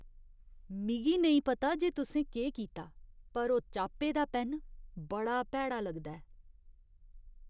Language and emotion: Dogri, disgusted